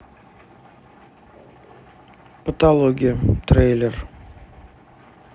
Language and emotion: Russian, neutral